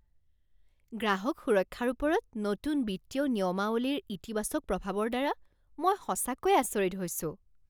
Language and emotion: Assamese, surprised